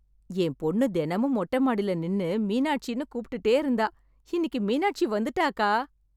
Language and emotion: Tamil, happy